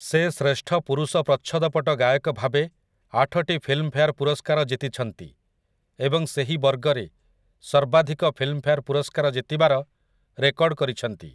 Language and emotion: Odia, neutral